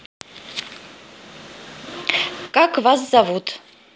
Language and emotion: Russian, positive